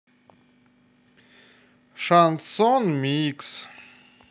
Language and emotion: Russian, neutral